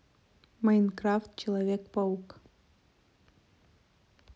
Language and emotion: Russian, neutral